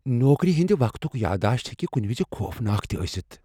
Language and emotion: Kashmiri, fearful